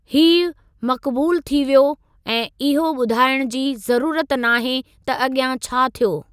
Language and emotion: Sindhi, neutral